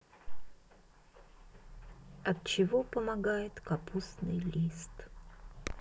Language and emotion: Russian, sad